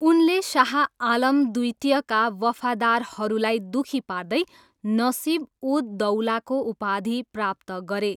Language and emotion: Nepali, neutral